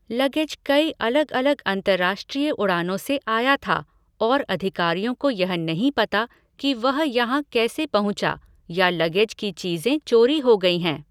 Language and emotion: Hindi, neutral